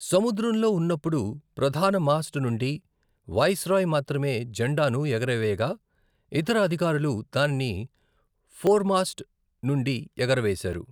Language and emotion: Telugu, neutral